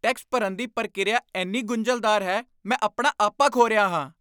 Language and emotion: Punjabi, angry